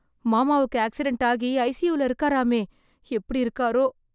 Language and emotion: Tamil, fearful